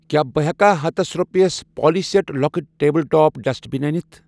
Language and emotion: Kashmiri, neutral